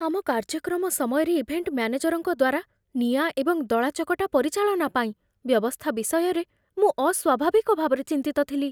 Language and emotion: Odia, fearful